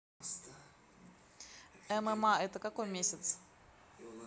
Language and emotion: Russian, neutral